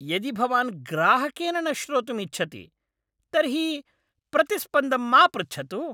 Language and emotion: Sanskrit, angry